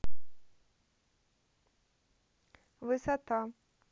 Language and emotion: Russian, neutral